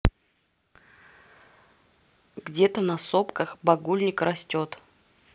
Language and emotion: Russian, neutral